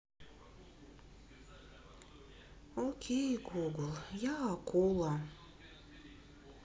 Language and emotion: Russian, sad